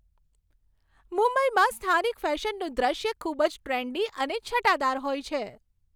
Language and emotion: Gujarati, happy